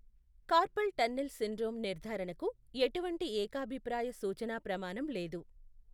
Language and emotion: Telugu, neutral